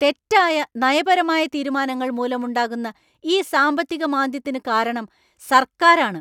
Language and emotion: Malayalam, angry